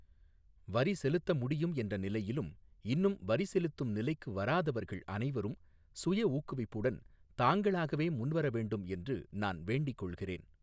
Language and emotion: Tamil, neutral